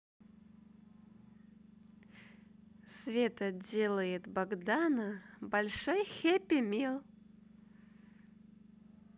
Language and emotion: Russian, positive